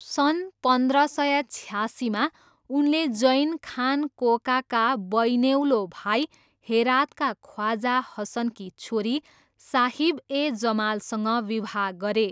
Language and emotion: Nepali, neutral